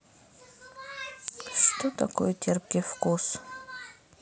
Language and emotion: Russian, sad